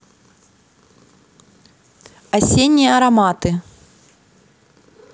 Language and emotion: Russian, neutral